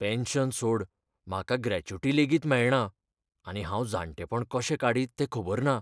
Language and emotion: Goan Konkani, fearful